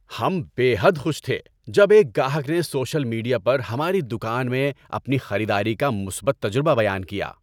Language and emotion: Urdu, happy